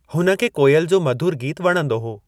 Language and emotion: Sindhi, neutral